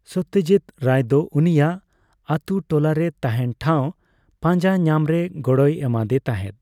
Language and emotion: Santali, neutral